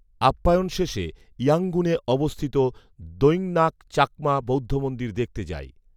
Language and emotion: Bengali, neutral